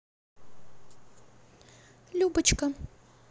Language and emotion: Russian, neutral